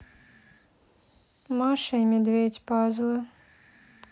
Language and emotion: Russian, neutral